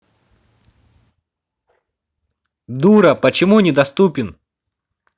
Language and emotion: Russian, angry